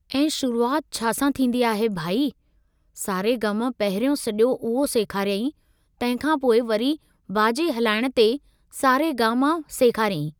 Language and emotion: Sindhi, neutral